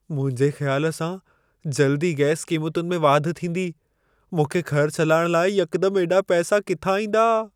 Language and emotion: Sindhi, fearful